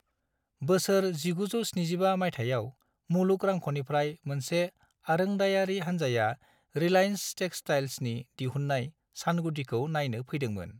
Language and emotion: Bodo, neutral